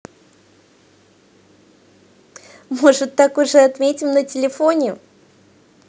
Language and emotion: Russian, positive